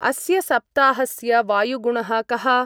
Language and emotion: Sanskrit, neutral